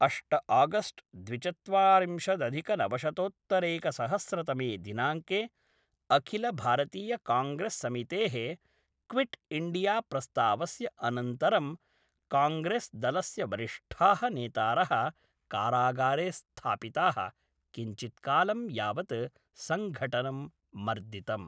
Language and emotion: Sanskrit, neutral